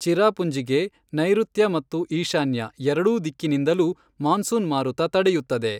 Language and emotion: Kannada, neutral